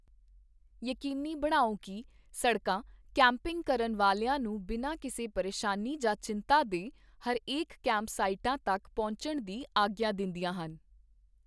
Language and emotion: Punjabi, neutral